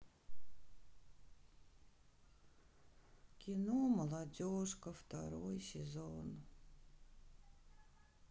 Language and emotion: Russian, sad